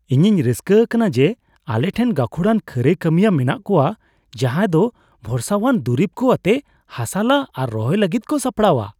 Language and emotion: Santali, happy